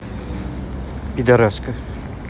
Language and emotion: Russian, angry